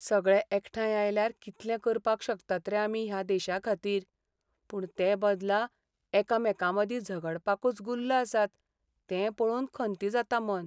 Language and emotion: Goan Konkani, sad